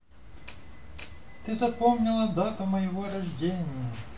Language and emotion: Russian, positive